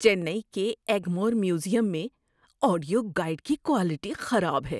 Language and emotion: Urdu, disgusted